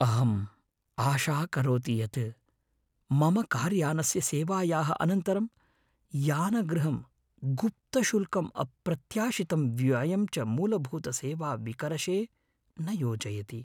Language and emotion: Sanskrit, fearful